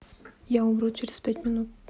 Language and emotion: Russian, neutral